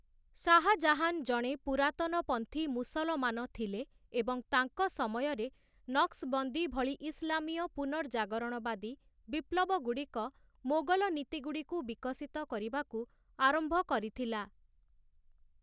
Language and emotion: Odia, neutral